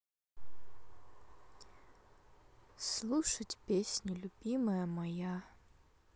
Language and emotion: Russian, sad